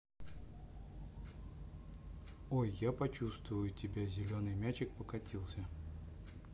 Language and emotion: Russian, neutral